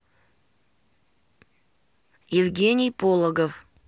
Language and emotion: Russian, neutral